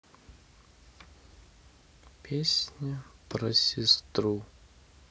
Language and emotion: Russian, sad